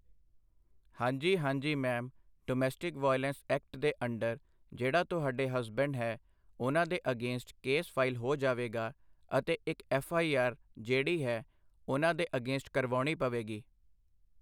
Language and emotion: Punjabi, neutral